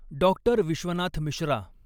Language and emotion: Marathi, neutral